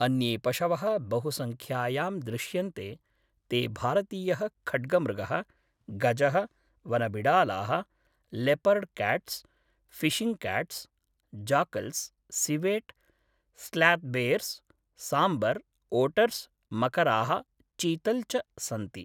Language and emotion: Sanskrit, neutral